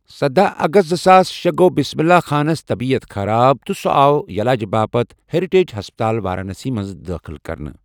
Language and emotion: Kashmiri, neutral